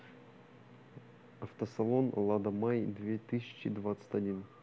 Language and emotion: Russian, neutral